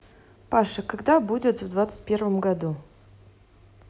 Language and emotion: Russian, neutral